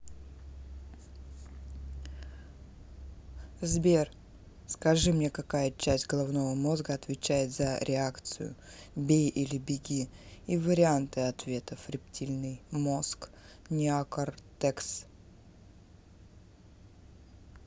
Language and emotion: Russian, neutral